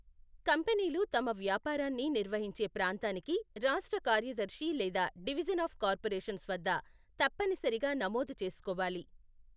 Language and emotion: Telugu, neutral